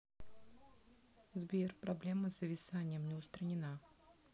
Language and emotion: Russian, neutral